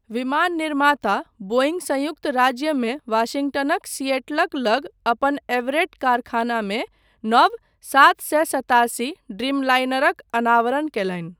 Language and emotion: Maithili, neutral